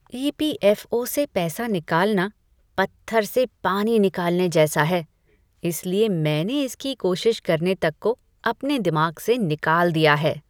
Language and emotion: Hindi, disgusted